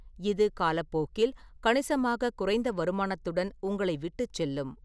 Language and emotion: Tamil, neutral